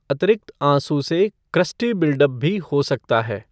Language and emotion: Hindi, neutral